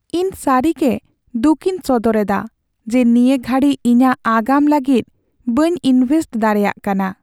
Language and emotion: Santali, sad